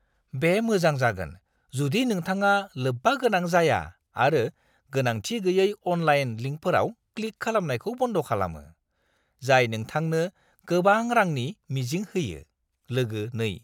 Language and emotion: Bodo, disgusted